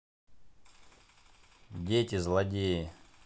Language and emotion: Russian, neutral